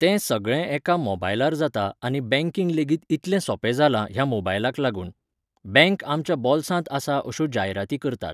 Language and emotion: Goan Konkani, neutral